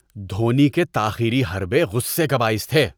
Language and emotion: Urdu, disgusted